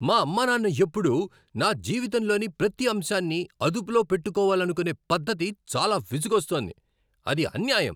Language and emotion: Telugu, angry